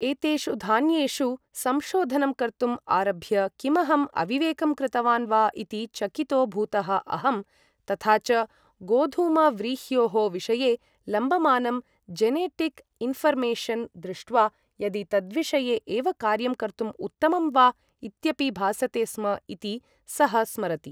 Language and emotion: Sanskrit, neutral